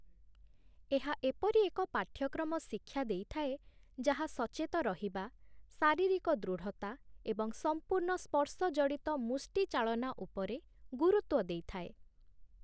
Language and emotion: Odia, neutral